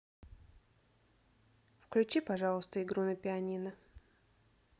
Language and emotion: Russian, neutral